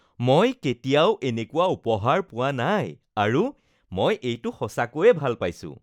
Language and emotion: Assamese, happy